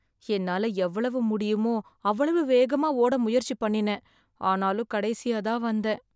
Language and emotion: Tamil, sad